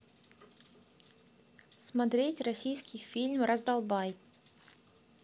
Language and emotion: Russian, neutral